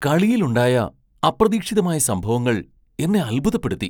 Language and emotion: Malayalam, surprised